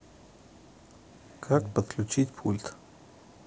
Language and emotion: Russian, neutral